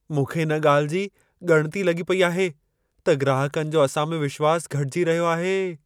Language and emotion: Sindhi, fearful